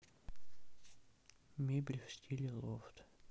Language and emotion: Russian, sad